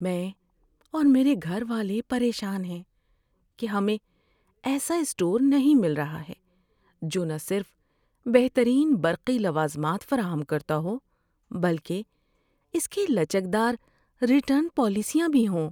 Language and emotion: Urdu, sad